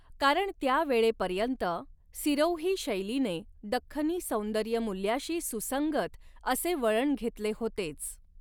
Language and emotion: Marathi, neutral